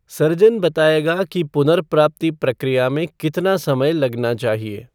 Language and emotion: Hindi, neutral